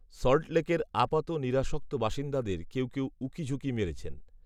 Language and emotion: Bengali, neutral